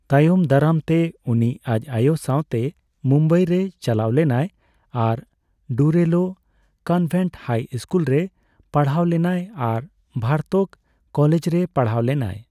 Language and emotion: Santali, neutral